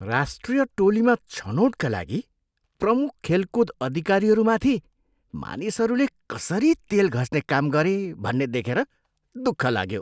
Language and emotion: Nepali, disgusted